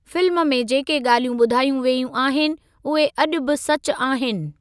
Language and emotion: Sindhi, neutral